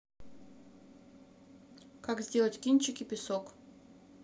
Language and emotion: Russian, neutral